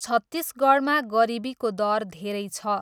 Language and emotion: Nepali, neutral